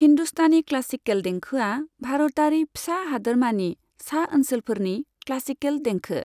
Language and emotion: Bodo, neutral